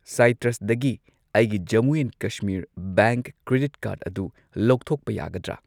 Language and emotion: Manipuri, neutral